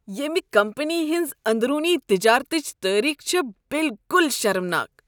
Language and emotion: Kashmiri, disgusted